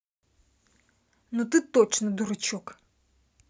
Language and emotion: Russian, angry